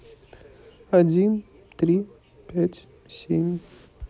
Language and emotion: Russian, neutral